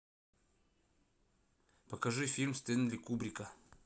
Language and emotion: Russian, neutral